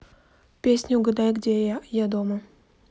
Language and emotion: Russian, neutral